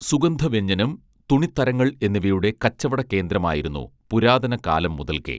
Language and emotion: Malayalam, neutral